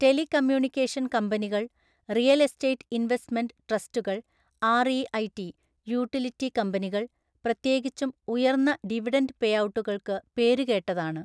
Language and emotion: Malayalam, neutral